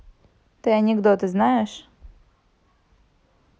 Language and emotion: Russian, neutral